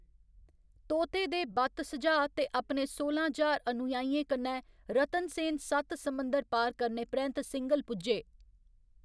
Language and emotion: Dogri, neutral